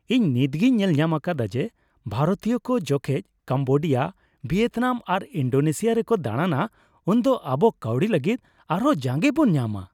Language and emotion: Santali, happy